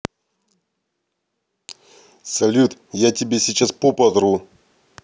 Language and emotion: Russian, positive